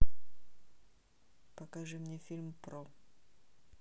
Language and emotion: Russian, neutral